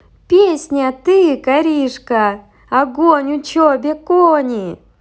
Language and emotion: Russian, positive